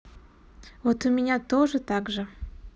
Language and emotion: Russian, neutral